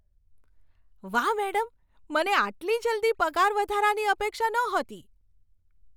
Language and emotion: Gujarati, surprised